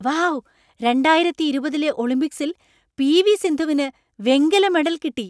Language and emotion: Malayalam, surprised